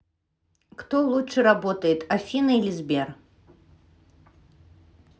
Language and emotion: Russian, neutral